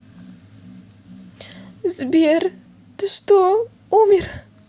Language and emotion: Russian, sad